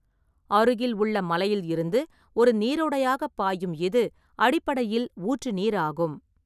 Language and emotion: Tamil, neutral